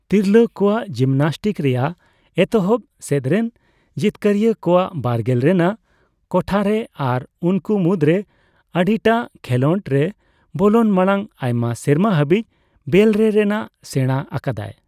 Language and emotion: Santali, neutral